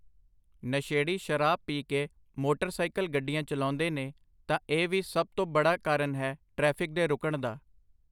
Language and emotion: Punjabi, neutral